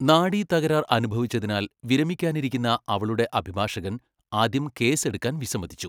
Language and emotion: Malayalam, neutral